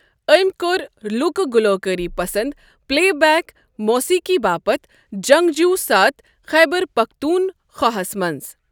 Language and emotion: Kashmiri, neutral